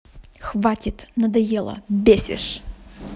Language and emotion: Russian, angry